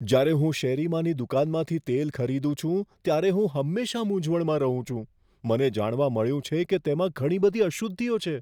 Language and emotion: Gujarati, fearful